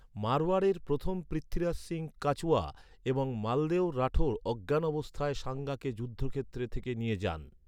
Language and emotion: Bengali, neutral